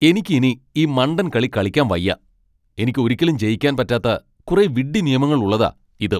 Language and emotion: Malayalam, angry